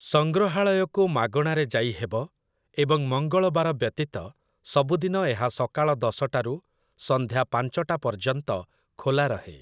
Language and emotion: Odia, neutral